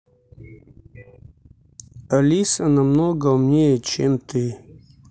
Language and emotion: Russian, neutral